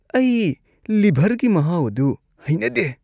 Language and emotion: Manipuri, disgusted